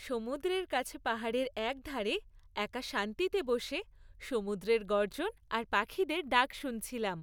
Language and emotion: Bengali, happy